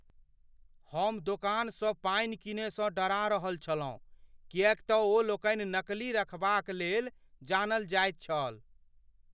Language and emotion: Maithili, fearful